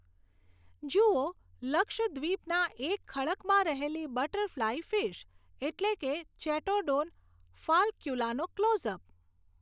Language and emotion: Gujarati, neutral